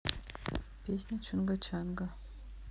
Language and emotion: Russian, neutral